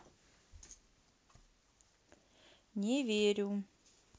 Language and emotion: Russian, neutral